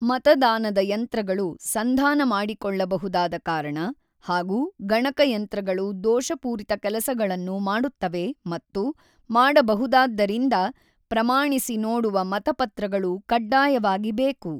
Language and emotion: Kannada, neutral